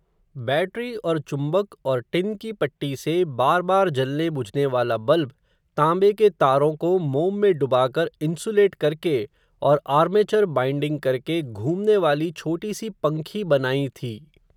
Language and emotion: Hindi, neutral